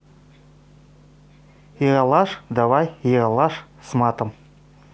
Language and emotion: Russian, positive